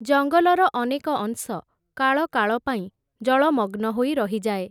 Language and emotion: Odia, neutral